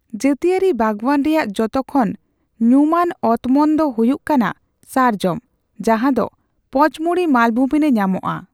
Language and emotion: Santali, neutral